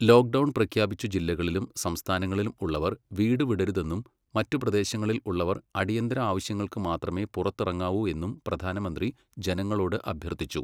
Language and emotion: Malayalam, neutral